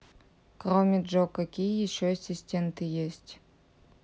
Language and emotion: Russian, neutral